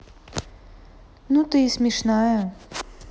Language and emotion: Russian, neutral